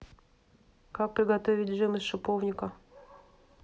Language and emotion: Russian, neutral